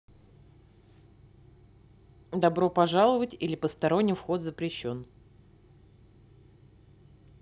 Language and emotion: Russian, neutral